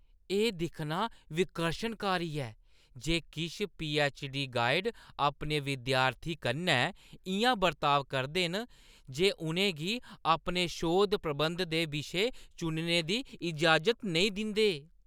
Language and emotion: Dogri, disgusted